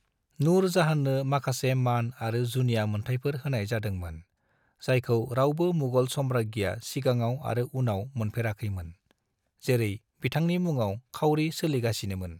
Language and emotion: Bodo, neutral